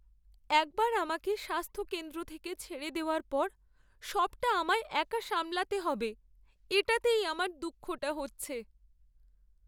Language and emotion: Bengali, sad